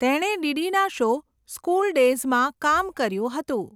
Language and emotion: Gujarati, neutral